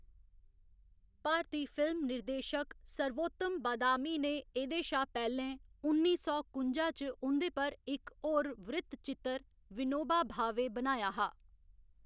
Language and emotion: Dogri, neutral